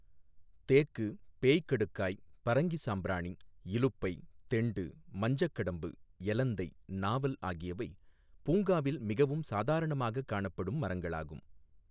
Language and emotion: Tamil, neutral